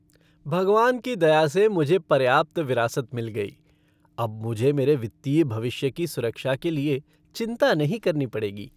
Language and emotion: Hindi, happy